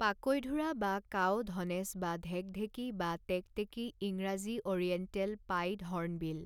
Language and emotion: Assamese, neutral